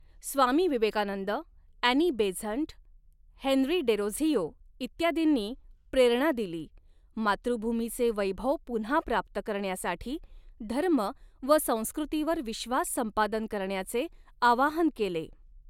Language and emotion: Marathi, neutral